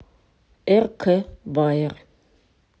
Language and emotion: Russian, neutral